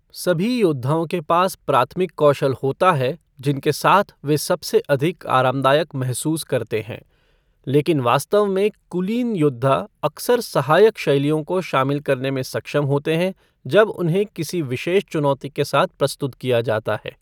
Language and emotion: Hindi, neutral